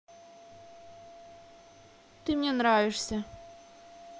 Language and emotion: Russian, neutral